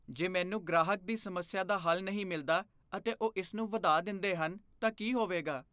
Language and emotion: Punjabi, fearful